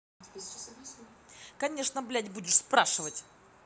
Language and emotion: Russian, angry